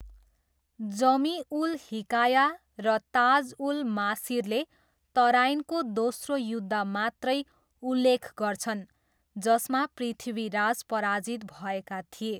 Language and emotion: Nepali, neutral